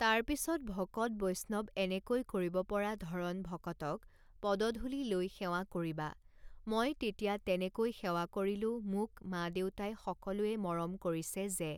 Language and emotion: Assamese, neutral